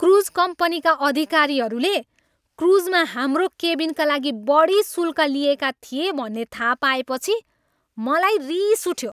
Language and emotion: Nepali, angry